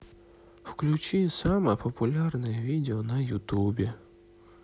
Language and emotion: Russian, sad